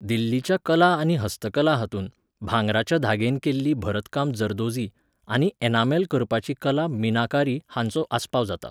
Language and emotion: Goan Konkani, neutral